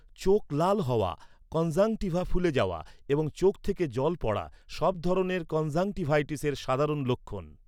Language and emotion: Bengali, neutral